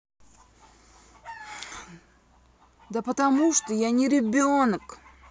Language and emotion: Russian, angry